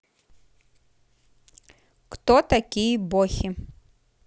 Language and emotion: Russian, neutral